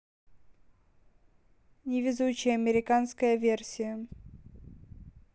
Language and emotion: Russian, neutral